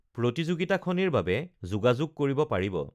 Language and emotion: Assamese, neutral